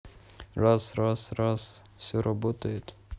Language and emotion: Russian, neutral